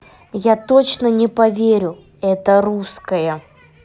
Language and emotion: Russian, neutral